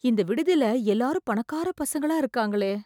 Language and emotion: Tamil, fearful